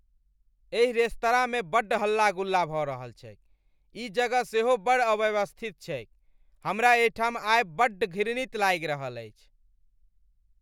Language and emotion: Maithili, angry